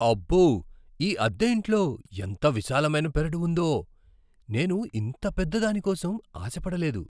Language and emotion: Telugu, surprised